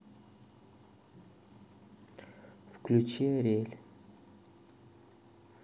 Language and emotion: Russian, neutral